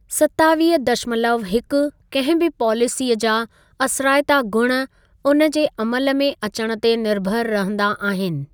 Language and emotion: Sindhi, neutral